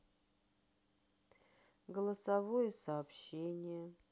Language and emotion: Russian, sad